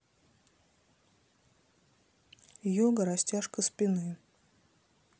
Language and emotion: Russian, neutral